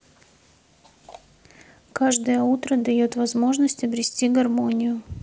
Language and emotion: Russian, neutral